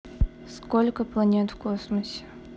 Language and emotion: Russian, neutral